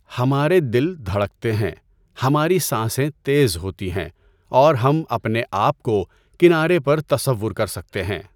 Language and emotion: Urdu, neutral